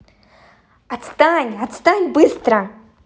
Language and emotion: Russian, angry